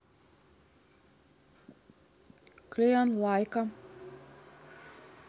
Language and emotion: Russian, neutral